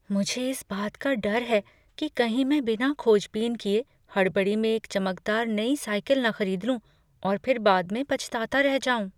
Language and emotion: Hindi, fearful